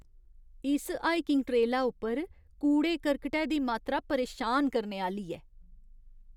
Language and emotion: Dogri, disgusted